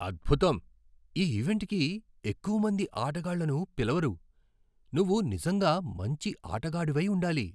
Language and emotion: Telugu, surprised